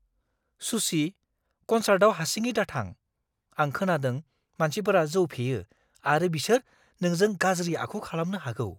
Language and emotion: Bodo, fearful